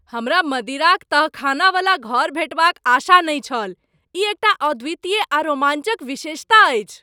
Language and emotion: Maithili, surprised